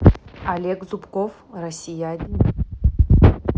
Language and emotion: Russian, neutral